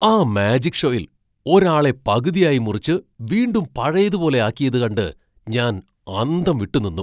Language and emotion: Malayalam, surprised